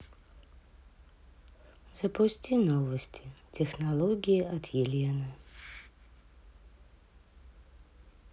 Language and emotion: Russian, sad